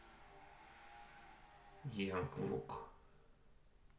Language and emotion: Russian, neutral